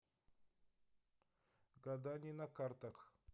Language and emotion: Russian, neutral